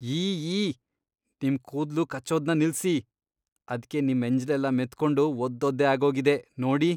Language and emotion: Kannada, disgusted